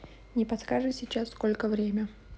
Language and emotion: Russian, neutral